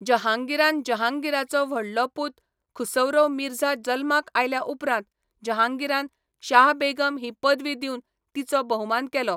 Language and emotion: Goan Konkani, neutral